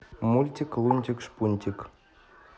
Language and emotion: Russian, neutral